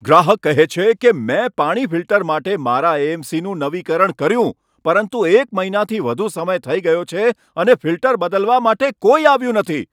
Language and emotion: Gujarati, angry